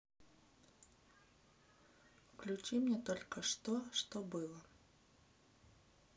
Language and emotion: Russian, neutral